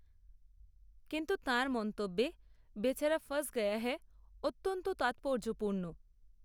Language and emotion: Bengali, neutral